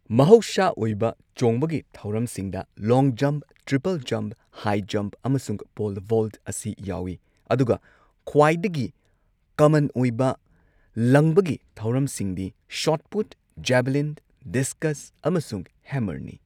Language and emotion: Manipuri, neutral